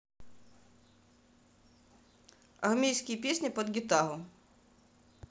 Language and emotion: Russian, neutral